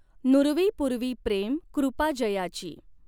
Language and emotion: Marathi, neutral